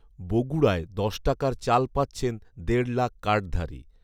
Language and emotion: Bengali, neutral